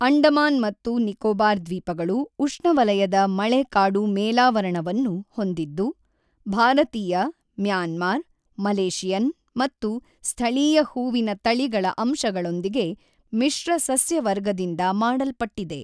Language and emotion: Kannada, neutral